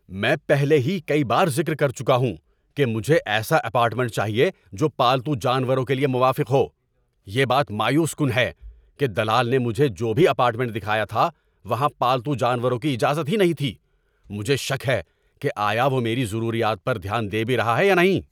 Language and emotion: Urdu, angry